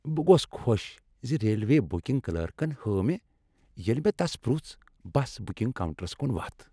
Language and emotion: Kashmiri, happy